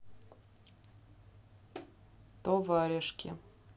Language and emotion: Russian, neutral